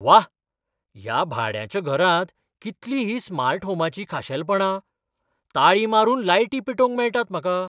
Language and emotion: Goan Konkani, surprised